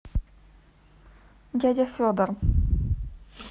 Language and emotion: Russian, neutral